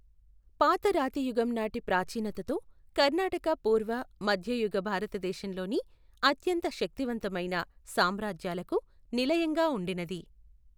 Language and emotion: Telugu, neutral